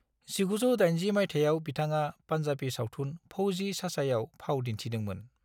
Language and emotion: Bodo, neutral